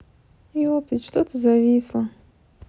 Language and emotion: Russian, sad